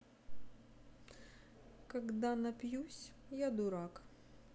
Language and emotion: Russian, sad